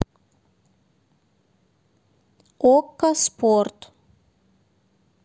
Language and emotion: Russian, neutral